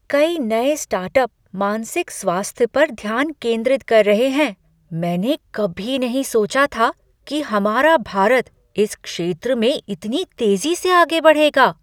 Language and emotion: Hindi, surprised